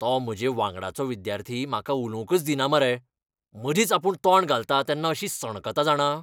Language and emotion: Goan Konkani, angry